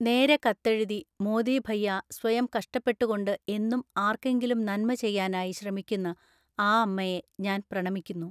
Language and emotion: Malayalam, neutral